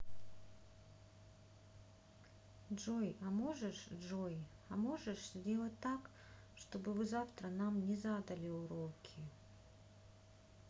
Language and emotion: Russian, sad